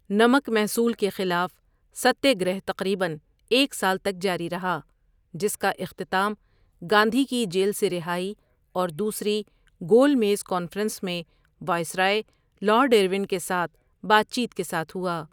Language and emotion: Urdu, neutral